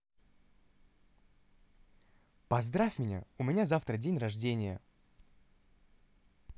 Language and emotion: Russian, positive